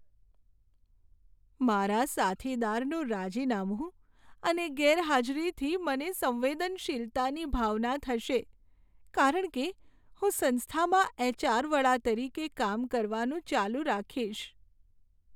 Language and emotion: Gujarati, sad